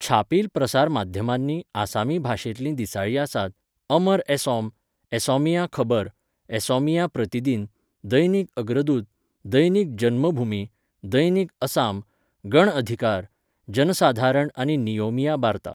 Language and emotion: Goan Konkani, neutral